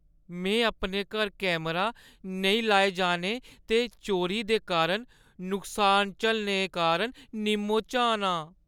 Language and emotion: Dogri, sad